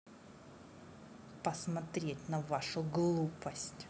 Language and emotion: Russian, angry